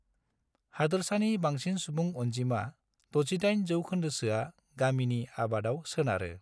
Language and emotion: Bodo, neutral